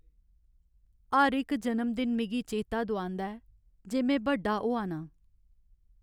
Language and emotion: Dogri, sad